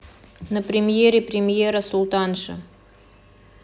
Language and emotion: Russian, neutral